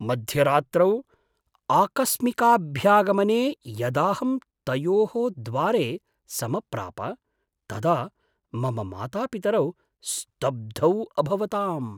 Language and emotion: Sanskrit, surprised